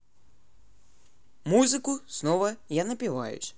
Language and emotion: Russian, neutral